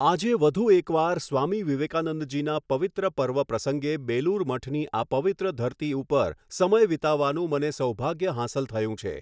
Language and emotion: Gujarati, neutral